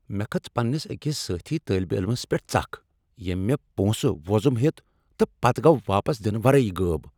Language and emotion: Kashmiri, angry